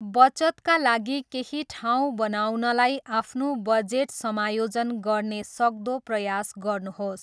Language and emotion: Nepali, neutral